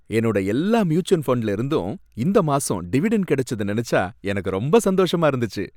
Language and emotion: Tamil, happy